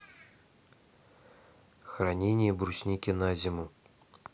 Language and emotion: Russian, neutral